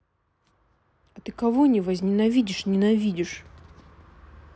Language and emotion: Russian, neutral